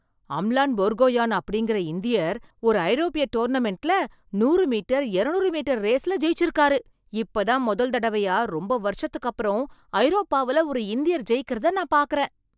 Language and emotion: Tamil, surprised